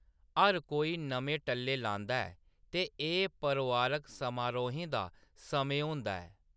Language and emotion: Dogri, neutral